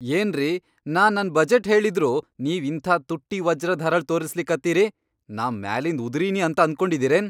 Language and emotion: Kannada, angry